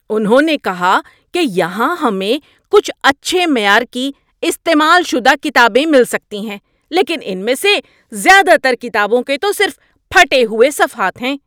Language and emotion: Urdu, angry